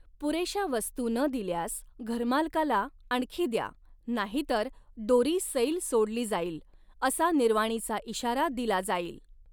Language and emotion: Marathi, neutral